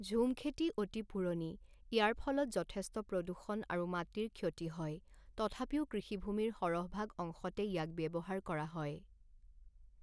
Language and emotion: Assamese, neutral